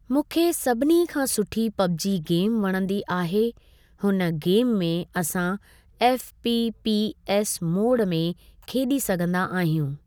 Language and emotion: Sindhi, neutral